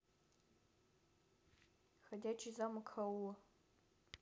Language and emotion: Russian, neutral